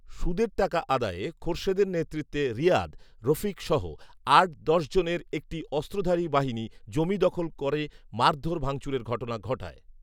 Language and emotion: Bengali, neutral